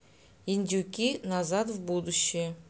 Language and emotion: Russian, neutral